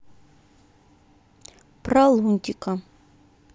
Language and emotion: Russian, neutral